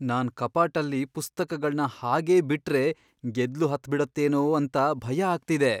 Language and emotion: Kannada, fearful